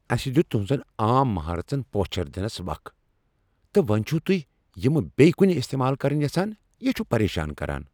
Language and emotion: Kashmiri, angry